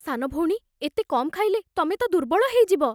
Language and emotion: Odia, fearful